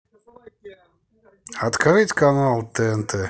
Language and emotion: Russian, neutral